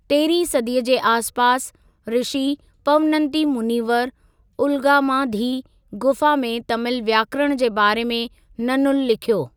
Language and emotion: Sindhi, neutral